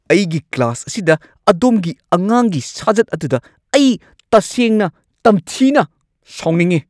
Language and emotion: Manipuri, angry